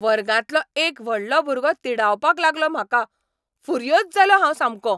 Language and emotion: Goan Konkani, angry